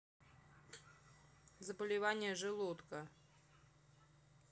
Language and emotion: Russian, neutral